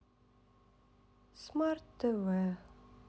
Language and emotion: Russian, sad